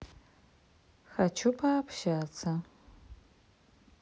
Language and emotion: Russian, neutral